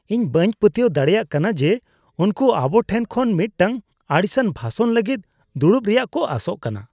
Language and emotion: Santali, disgusted